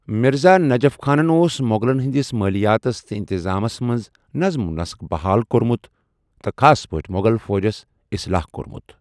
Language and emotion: Kashmiri, neutral